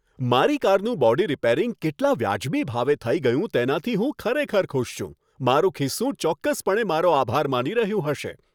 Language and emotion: Gujarati, happy